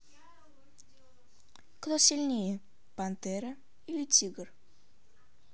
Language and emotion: Russian, neutral